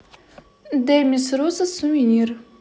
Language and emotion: Russian, neutral